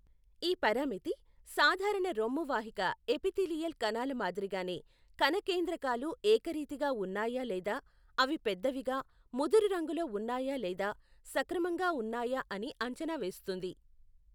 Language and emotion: Telugu, neutral